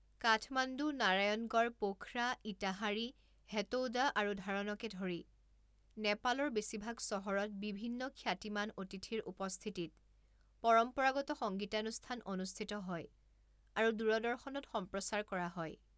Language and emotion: Assamese, neutral